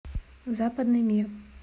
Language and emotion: Russian, neutral